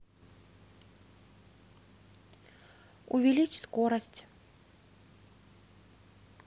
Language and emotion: Russian, neutral